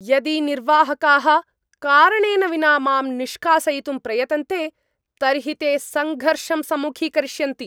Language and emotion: Sanskrit, angry